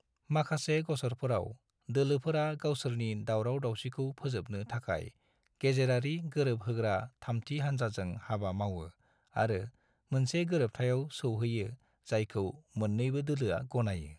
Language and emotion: Bodo, neutral